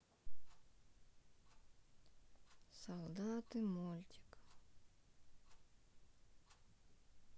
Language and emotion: Russian, sad